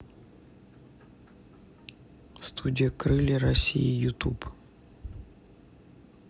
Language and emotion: Russian, neutral